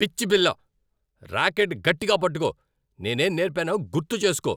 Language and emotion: Telugu, angry